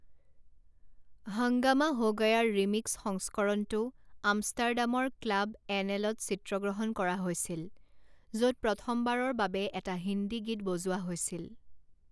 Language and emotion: Assamese, neutral